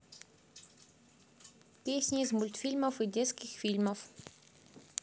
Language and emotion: Russian, neutral